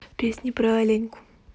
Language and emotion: Russian, neutral